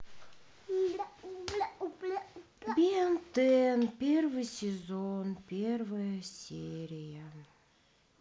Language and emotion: Russian, sad